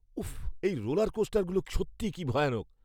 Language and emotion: Bengali, fearful